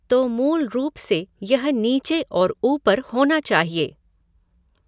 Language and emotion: Hindi, neutral